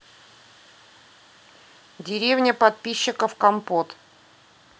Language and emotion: Russian, neutral